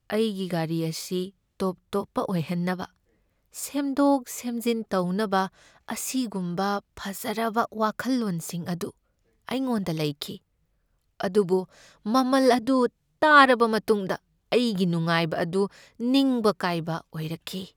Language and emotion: Manipuri, sad